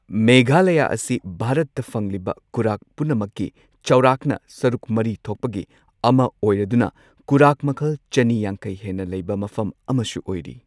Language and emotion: Manipuri, neutral